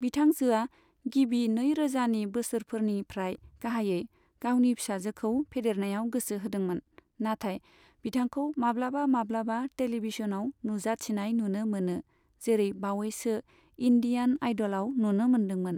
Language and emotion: Bodo, neutral